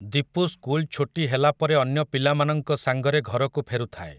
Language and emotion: Odia, neutral